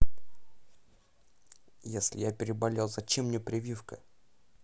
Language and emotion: Russian, angry